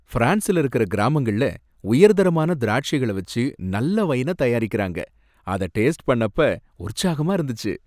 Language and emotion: Tamil, happy